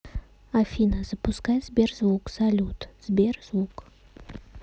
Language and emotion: Russian, neutral